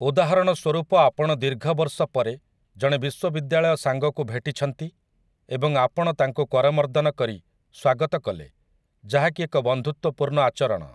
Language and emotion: Odia, neutral